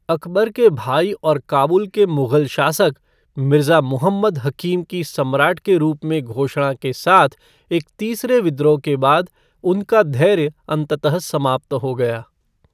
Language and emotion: Hindi, neutral